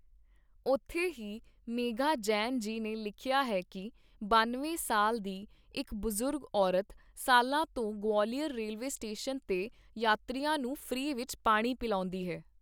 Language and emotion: Punjabi, neutral